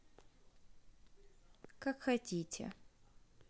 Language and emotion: Russian, neutral